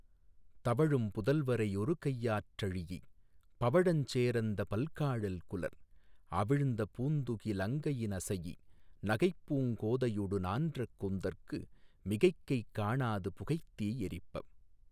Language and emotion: Tamil, neutral